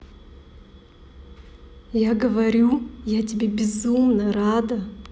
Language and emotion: Russian, positive